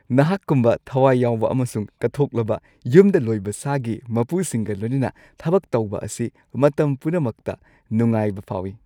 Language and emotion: Manipuri, happy